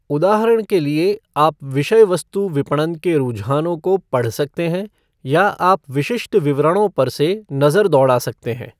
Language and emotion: Hindi, neutral